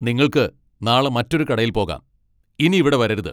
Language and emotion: Malayalam, angry